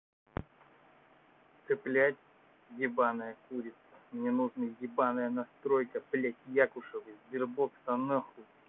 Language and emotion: Russian, angry